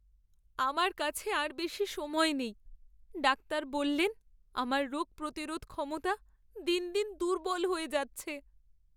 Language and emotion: Bengali, sad